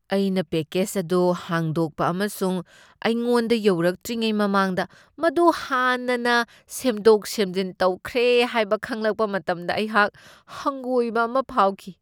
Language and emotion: Manipuri, disgusted